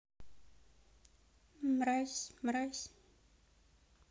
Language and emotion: Russian, neutral